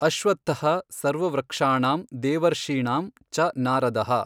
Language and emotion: Kannada, neutral